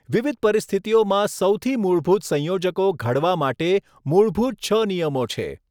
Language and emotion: Gujarati, neutral